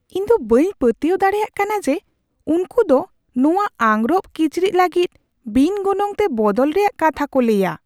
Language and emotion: Santali, surprised